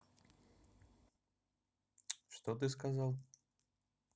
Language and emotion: Russian, neutral